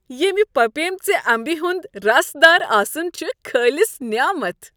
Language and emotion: Kashmiri, happy